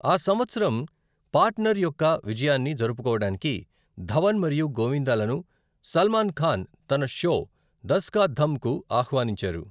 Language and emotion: Telugu, neutral